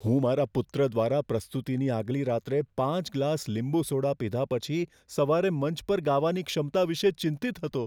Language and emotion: Gujarati, fearful